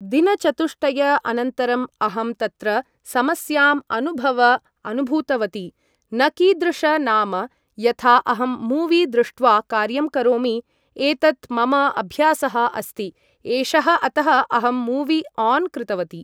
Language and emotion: Sanskrit, neutral